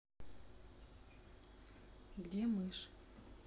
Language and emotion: Russian, neutral